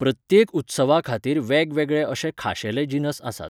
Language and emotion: Goan Konkani, neutral